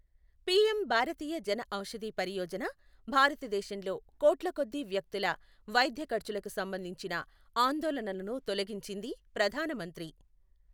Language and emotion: Telugu, neutral